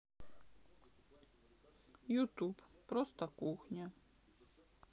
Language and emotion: Russian, sad